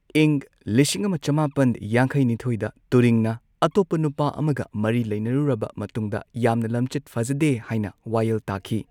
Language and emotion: Manipuri, neutral